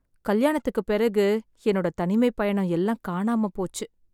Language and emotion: Tamil, sad